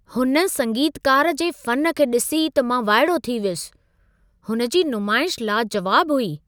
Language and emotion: Sindhi, surprised